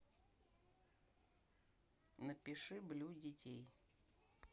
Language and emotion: Russian, neutral